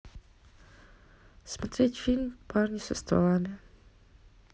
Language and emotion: Russian, neutral